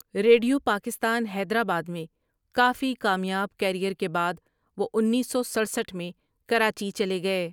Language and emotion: Urdu, neutral